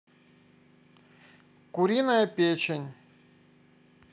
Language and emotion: Russian, neutral